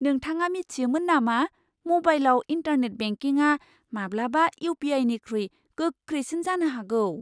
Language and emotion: Bodo, surprised